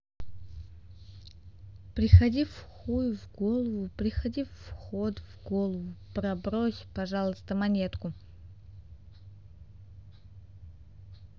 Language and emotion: Russian, neutral